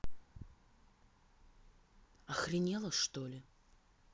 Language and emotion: Russian, angry